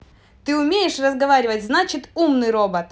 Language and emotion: Russian, neutral